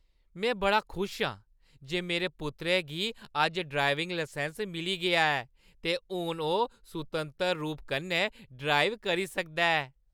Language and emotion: Dogri, happy